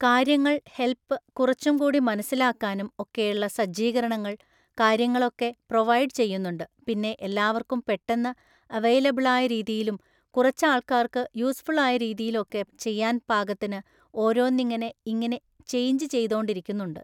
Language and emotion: Malayalam, neutral